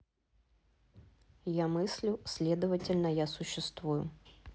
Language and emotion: Russian, neutral